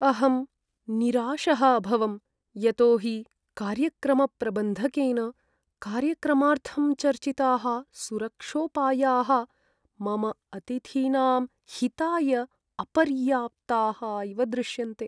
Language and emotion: Sanskrit, sad